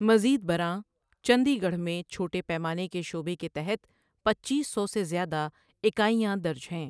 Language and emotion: Urdu, neutral